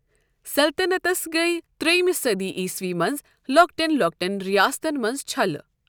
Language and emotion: Kashmiri, neutral